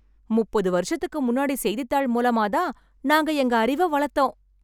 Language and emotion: Tamil, happy